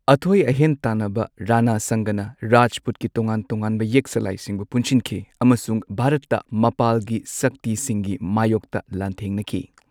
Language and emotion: Manipuri, neutral